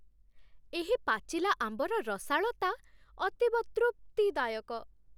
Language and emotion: Odia, happy